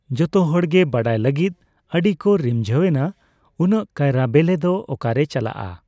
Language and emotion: Santali, neutral